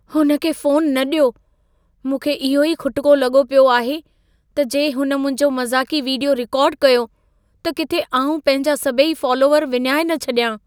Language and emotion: Sindhi, fearful